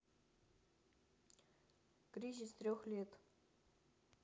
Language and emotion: Russian, neutral